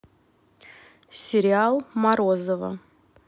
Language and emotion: Russian, neutral